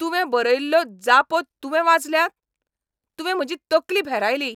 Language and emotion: Goan Konkani, angry